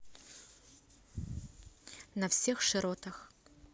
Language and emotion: Russian, neutral